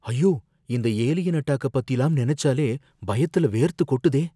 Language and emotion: Tamil, fearful